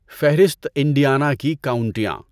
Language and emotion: Urdu, neutral